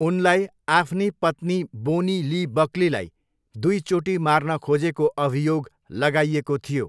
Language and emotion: Nepali, neutral